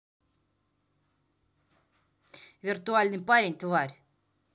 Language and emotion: Russian, angry